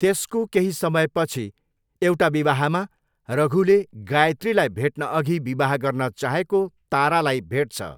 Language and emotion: Nepali, neutral